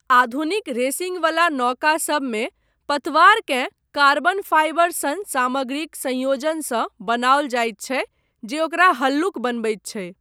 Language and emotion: Maithili, neutral